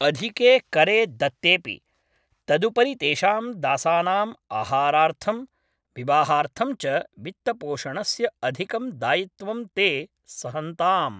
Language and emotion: Sanskrit, neutral